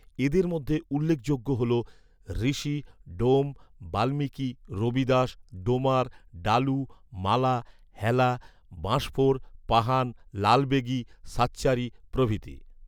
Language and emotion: Bengali, neutral